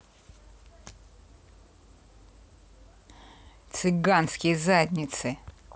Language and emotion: Russian, angry